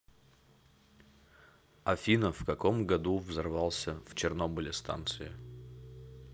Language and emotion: Russian, neutral